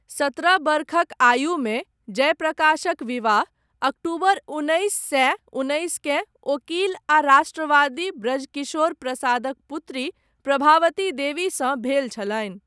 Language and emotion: Maithili, neutral